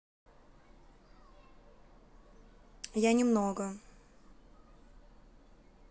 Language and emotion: Russian, neutral